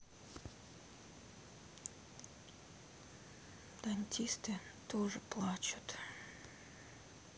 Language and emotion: Russian, sad